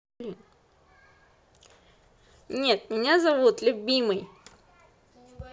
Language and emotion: Russian, neutral